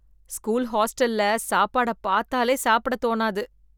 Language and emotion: Tamil, disgusted